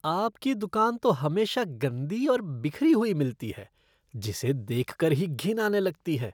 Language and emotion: Hindi, disgusted